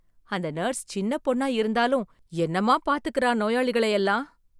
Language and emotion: Tamil, surprised